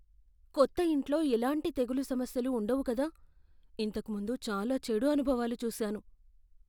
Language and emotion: Telugu, fearful